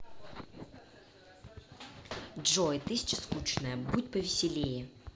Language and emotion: Russian, angry